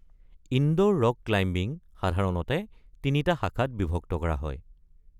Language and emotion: Assamese, neutral